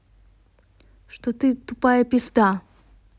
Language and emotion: Russian, angry